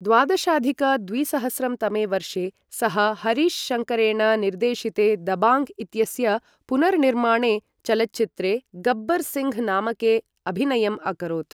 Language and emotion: Sanskrit, neutral